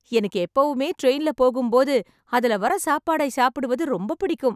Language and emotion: Tamil, happy